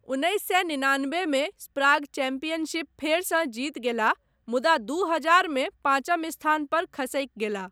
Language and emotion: Maithili, neutral